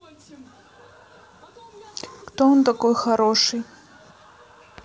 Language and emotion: Russian, neutral